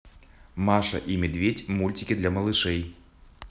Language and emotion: Russian, positive